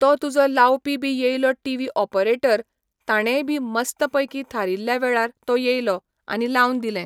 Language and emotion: Goan Konkani, neutral